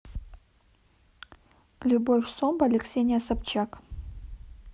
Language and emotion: Russian, neutral